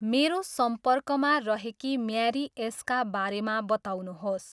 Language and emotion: Nepali, neutral